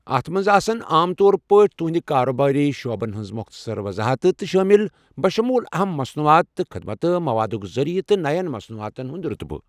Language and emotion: Kashmiri, neutral